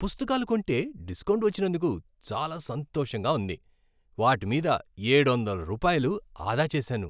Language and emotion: Telugu, happy